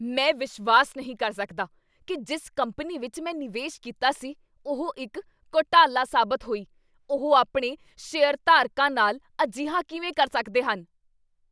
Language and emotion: Punjabi, angry